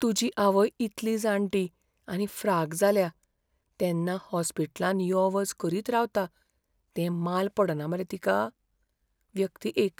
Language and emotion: Goan Konkani, fearful